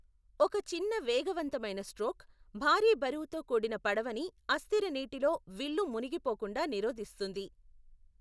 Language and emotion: Telugu, neutral